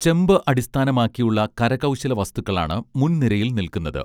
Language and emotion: Malayalam, neutral